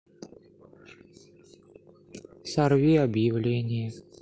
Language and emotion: Russian, sad